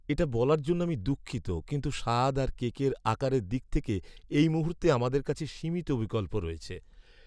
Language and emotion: Bengali, sad